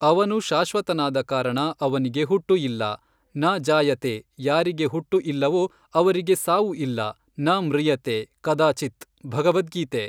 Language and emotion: Kannada, neutral